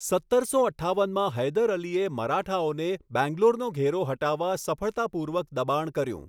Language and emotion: Gujarati, neutral